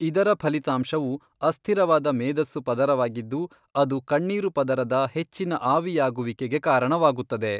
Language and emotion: Kannada, neutral